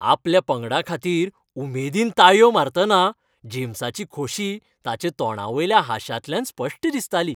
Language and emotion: Goan Konkani, happy